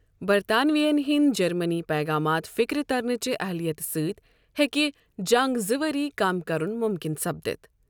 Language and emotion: Kashmiri, neutral